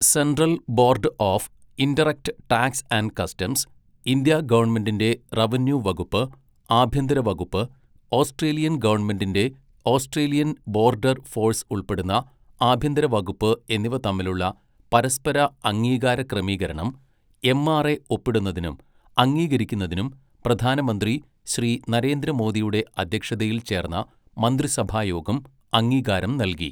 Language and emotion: Malayalam, neutral